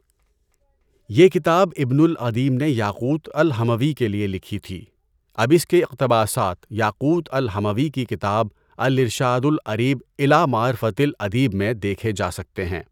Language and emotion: Urdu, neutral